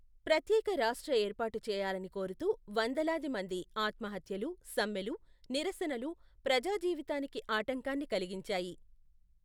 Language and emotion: Telugu, neutral